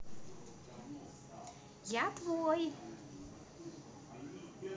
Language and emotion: Russian, positive